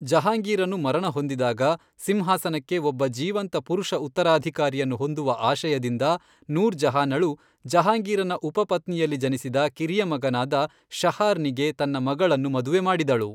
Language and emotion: Kannada, neutral